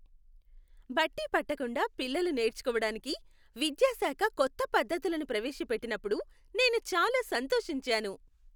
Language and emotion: Telugu, happy